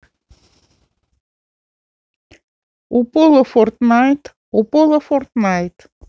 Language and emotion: Russian, neutral